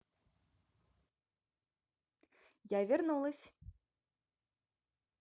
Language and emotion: Russian, positive